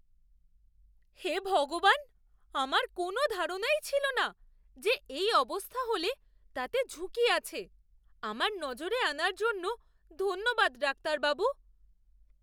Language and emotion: Bengali, surprised